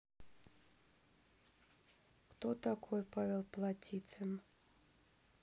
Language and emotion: Russian, neutral